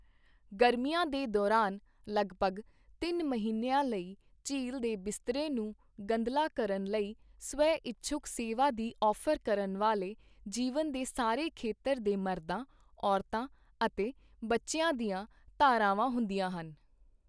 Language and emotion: Punjabi, neutral